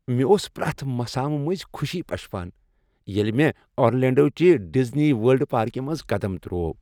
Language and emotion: Kashmiri, happy